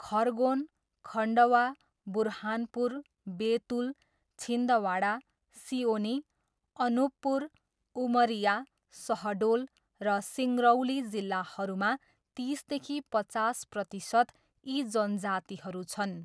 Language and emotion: Nepali, neutral